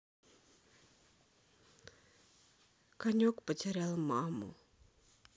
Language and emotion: Russian, sad